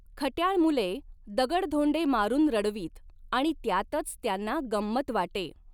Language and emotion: Marathi, neutral